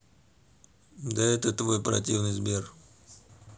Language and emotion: Russian, neutral